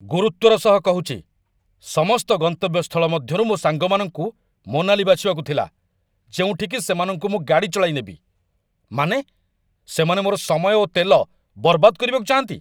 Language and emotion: Odia, angry